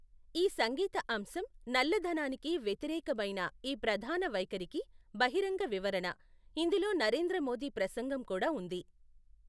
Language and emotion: Telugu, neutral